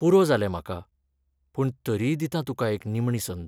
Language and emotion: Goan Konkani, sad